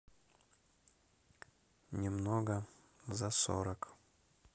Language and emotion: Russian, neutral